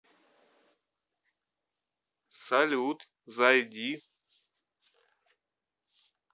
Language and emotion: Russian, neutral